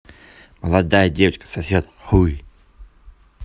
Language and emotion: Russian, neutral